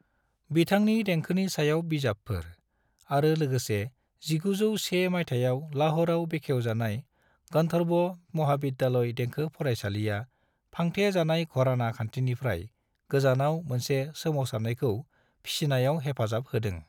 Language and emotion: Bodo, neutral